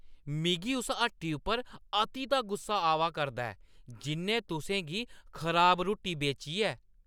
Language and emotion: Dogri, angry